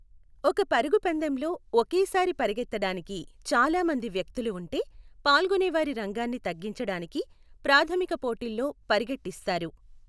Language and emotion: Telugu, neutral